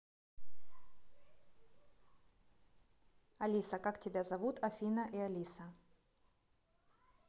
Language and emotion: Russian, neutral